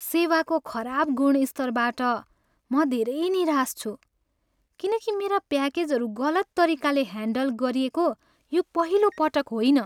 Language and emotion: Nepali, sad